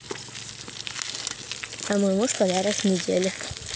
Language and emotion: Russian, neutral